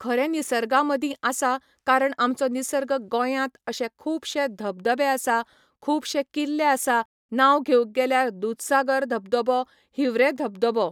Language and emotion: Goan Konkani, neutral